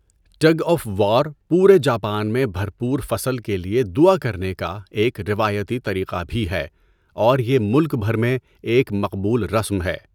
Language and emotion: Urdu, neutral